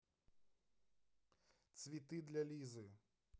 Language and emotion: Russian, neutral